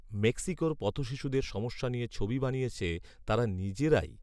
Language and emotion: Bengali, neutral